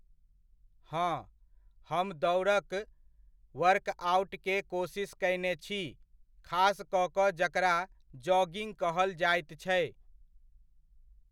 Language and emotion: Maithili, neutral